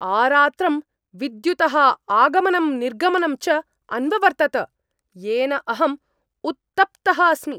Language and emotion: Sanskrit, angry